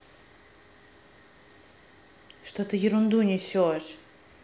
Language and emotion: Russian, angry